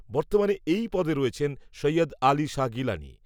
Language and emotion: Bengali, neutral